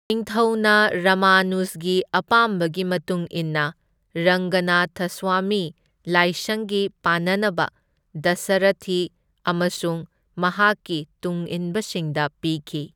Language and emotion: Manipuri, neutral